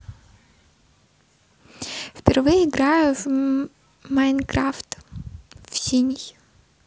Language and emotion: Russian, neutral